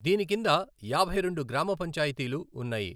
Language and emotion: Telugu, neutral